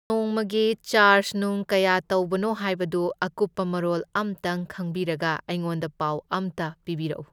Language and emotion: Manipuri, neutral